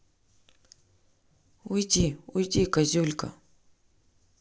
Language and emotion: Russian, neutral